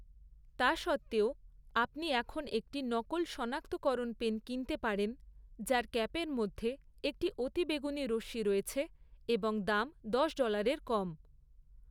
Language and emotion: Bengali, neutral